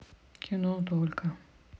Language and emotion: Russian, neutral